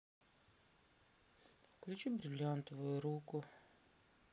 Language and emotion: Russian, sad